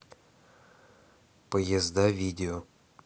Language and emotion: Russian, neutral